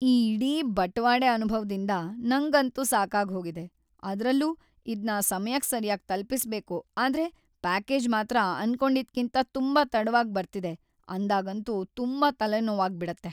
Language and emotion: Kannada, sad